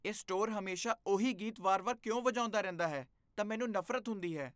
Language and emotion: Punjabi, disgusted